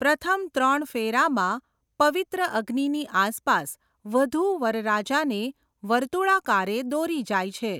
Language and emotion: Gujarati, neutral